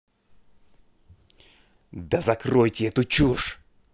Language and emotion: Russian, angry